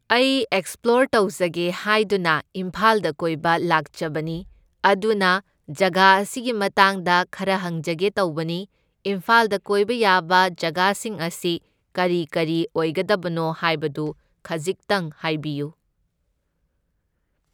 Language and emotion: Manipuri, neutral